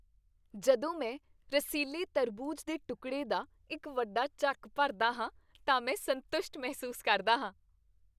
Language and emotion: Punjabi, happy